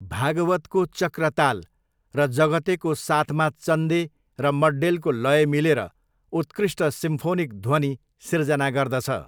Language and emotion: Nepali, neutral